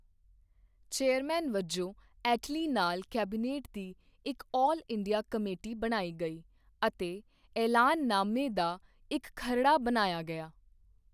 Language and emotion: Punjabi, neutral